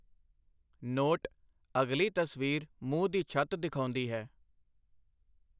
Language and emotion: Punjabi, neutral